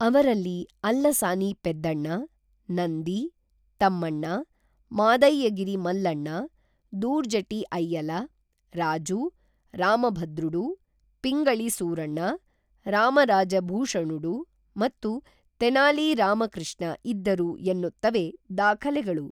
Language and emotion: Kannada, neutral